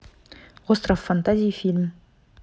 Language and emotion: Russian, neutral